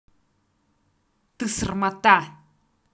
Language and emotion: Russian, angry